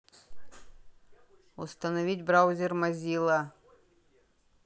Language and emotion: Russian, neutral